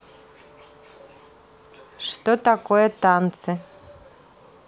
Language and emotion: Russian, neutral